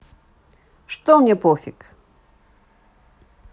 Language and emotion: Russian, positive